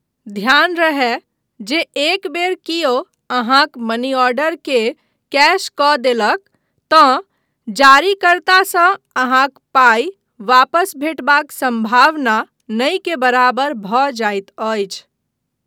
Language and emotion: Maithili, neutral